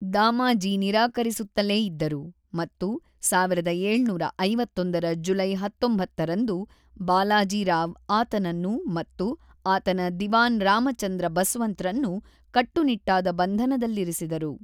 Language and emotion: Kannada, neutral